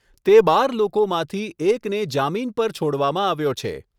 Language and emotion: Gujarati, neutral